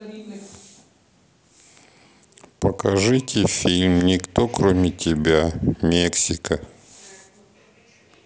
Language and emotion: Russian, sad